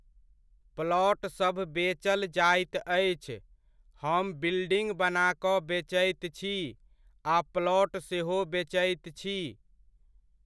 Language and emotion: Maithili, neutral